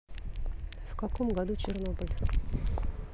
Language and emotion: Russian, neutral